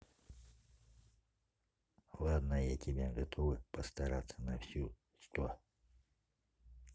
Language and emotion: Russian, neutral